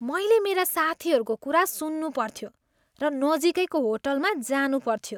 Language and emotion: Nepali, disgusted